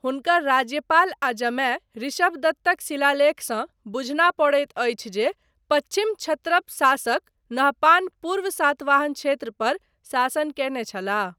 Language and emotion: Maithili, neutral